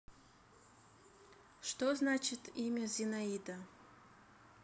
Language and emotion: Russian, neutral